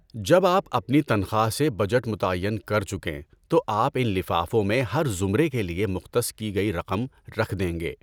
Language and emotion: Urdu, neutral